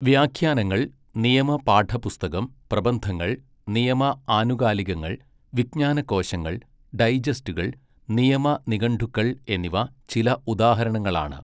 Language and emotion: Malayalam, neutral